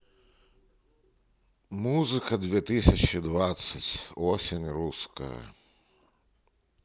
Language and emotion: Russian, neutral